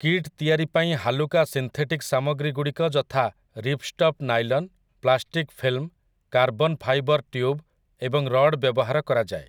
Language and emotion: Odia, neutral